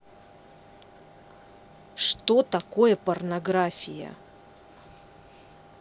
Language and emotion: Russian, neutral